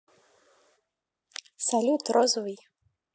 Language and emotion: Russian, neutral